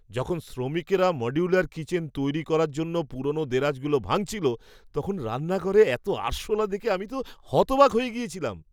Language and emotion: Bengali, surprised